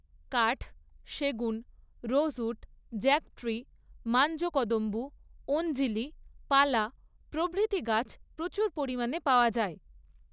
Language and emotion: Bengali, neutral